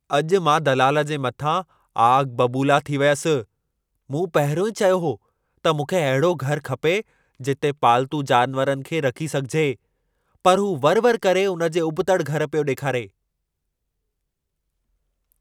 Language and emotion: Sindhi, angry